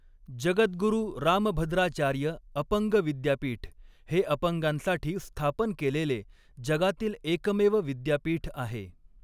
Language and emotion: Marathi, neutral